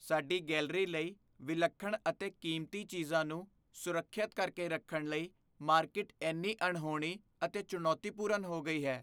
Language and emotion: Punjabi, fearful